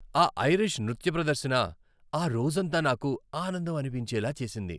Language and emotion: Telugu, happy